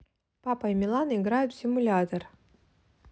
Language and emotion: Russian, neutral